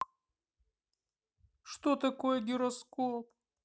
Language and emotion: Russian, sad